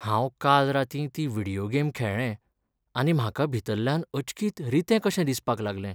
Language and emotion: Goan Konkani, sad